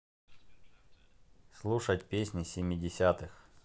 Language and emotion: Russian, neutral